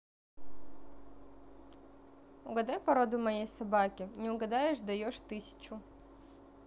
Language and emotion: Russian, neutral